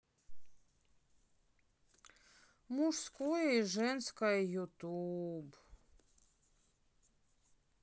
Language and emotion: Russian, sad